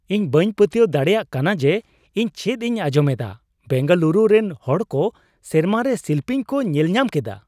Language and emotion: Santali, surprised